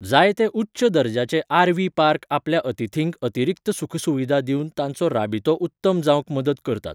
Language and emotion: Goan Konkani, neutral